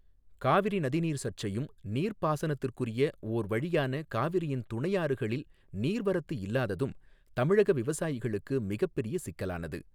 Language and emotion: Tamil, neutral